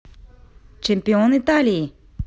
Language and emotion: Russian, positive